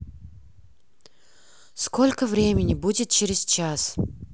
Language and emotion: Russian, angry